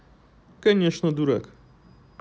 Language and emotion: Russian, neutral